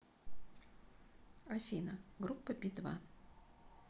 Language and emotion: Russian, neutral